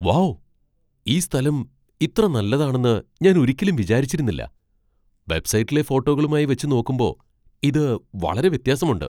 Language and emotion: Malayalam, surprised